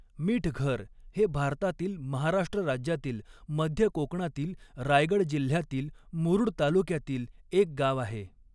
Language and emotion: Marathi, neutral